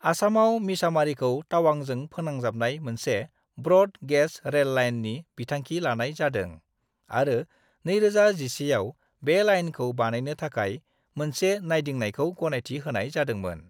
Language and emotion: Bodo, neutral